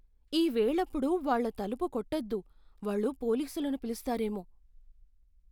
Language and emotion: Telugu, fearful